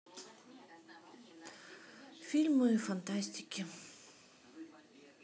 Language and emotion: Russian, neutral